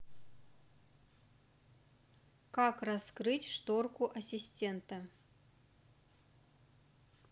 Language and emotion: Russian, neutral